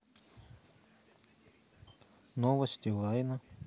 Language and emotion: Russian, neutral